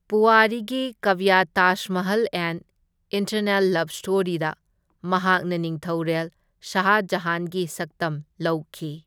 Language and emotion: Manipuri, neutral